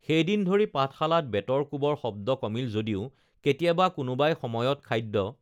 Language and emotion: Assamese, neutral